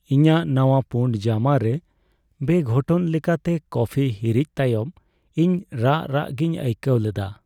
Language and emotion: Santali, sad